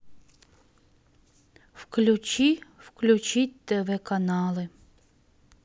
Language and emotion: Russian, sad